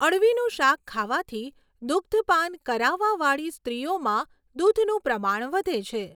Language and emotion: Gujarati, neutral